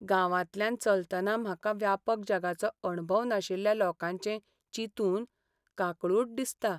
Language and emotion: Goan Konkani, sad